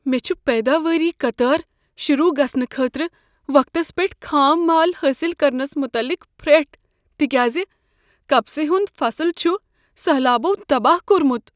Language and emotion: Kashmiri, fearful